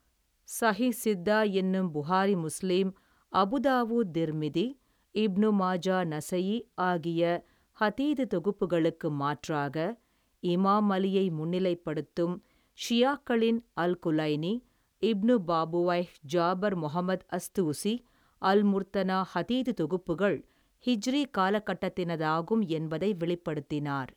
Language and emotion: Tamil, neutral